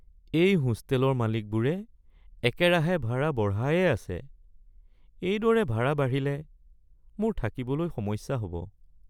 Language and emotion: Assamese, sad